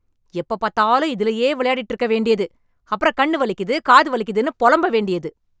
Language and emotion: Tamil, angry